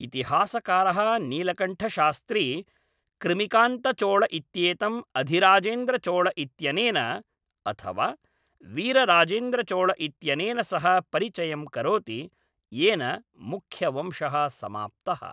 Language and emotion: Sanskrit, neutral